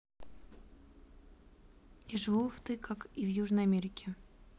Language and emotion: Russian, neutral